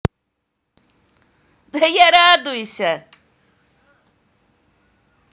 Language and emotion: Russian, positive